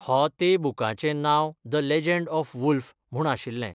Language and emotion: Goan Konkani, neutral